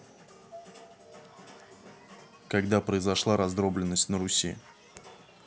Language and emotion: Russian, neutral